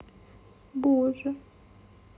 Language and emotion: Russian, sad